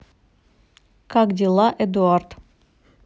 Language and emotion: Russian, neutral